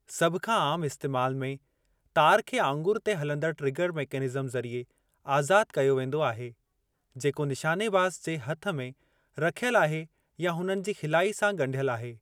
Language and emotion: Sindhi, neutral